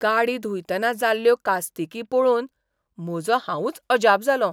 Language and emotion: Goan Konkani, surprised